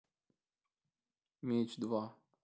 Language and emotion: Russian, neutral